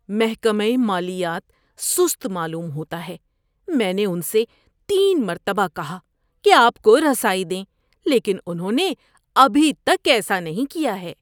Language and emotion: Urdu, disgusted